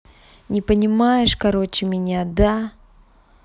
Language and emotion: Russian, angry